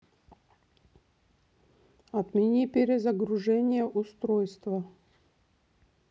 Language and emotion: Russian, neutral